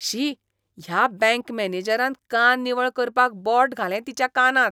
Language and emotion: Goan Konkani, disgusted